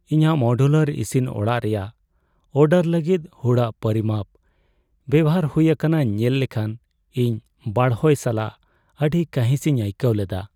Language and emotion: Santali, sad